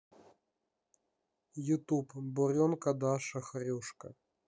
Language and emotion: Russian, neutral